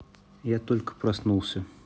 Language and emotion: Russian, neutral